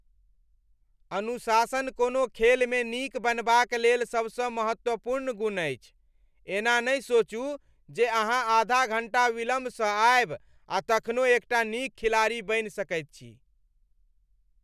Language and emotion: Maithili, angry